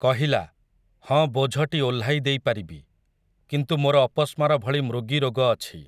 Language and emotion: Odia, neutral